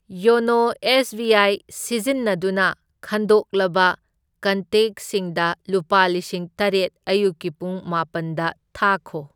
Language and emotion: Manipuri, neutral